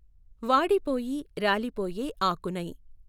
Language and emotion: Telugu, neutral